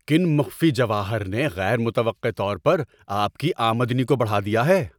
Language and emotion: Urdu, surprised